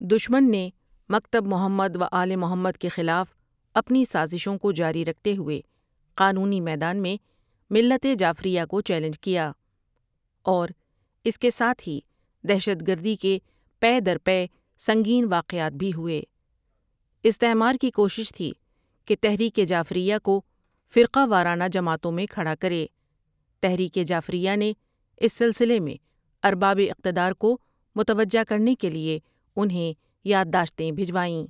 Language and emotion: Urdu, neutral